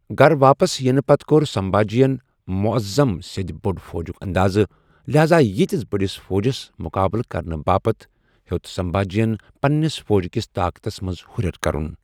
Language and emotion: Kashmiri, neutral